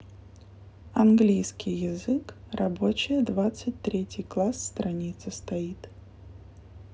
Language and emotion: Russian, neutral